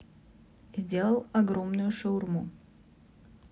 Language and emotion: Russian, neutral